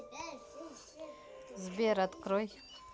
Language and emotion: Russian, neutral